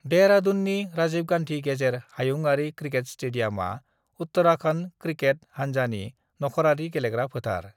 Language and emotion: Bodo, neutral